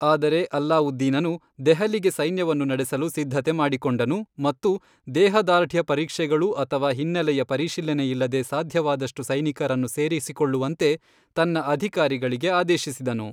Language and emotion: Kannada, neutral